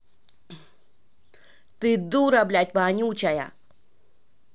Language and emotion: Russian, angry